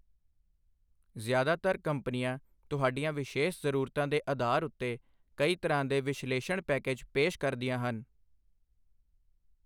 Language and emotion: Punjabi, neutral